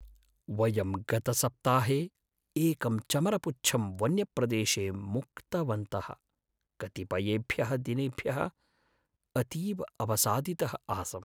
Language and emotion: Sanskrit, sad